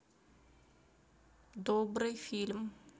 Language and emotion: Russian, neutral